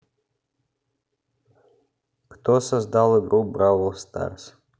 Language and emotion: Russian, neutral